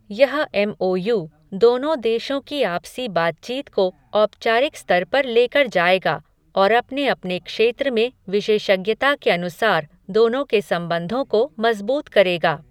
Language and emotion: Hindi, neutral